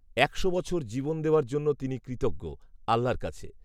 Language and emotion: Bengali, neutral